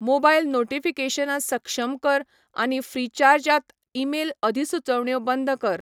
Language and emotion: Goan Konkani, neutral